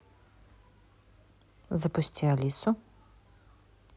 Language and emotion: Russian, neutral